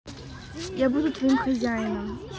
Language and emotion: Russian, neutral